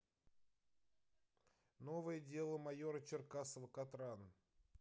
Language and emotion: Russian, neutral